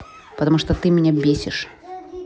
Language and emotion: Russian, angry